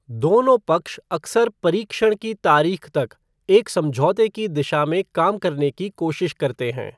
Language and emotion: Hindi, neutral